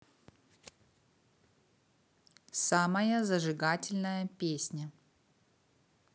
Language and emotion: Russian, neutral